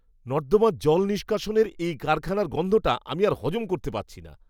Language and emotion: Bengali, disgusted